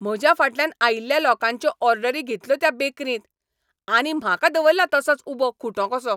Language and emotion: Goan Konkani, angry